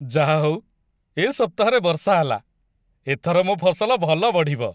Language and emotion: Odia, happy